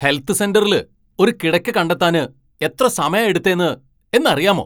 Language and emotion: Malayalam, angry